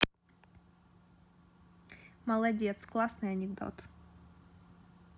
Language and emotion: Russian, positive